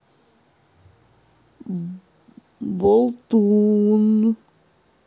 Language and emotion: Russian, neutral